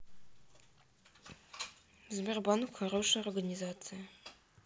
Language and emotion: Russian, neutral